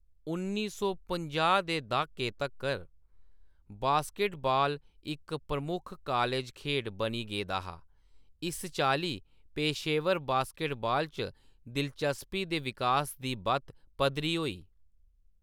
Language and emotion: Dogri, neutral